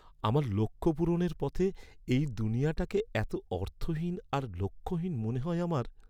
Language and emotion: Bengali, sad